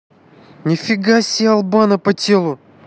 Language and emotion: Russian, angry